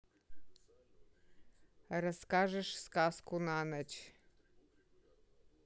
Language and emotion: Russian, angry